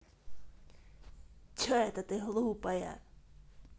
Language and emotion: Russian, angry